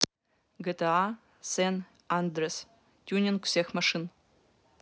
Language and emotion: Russian, neutral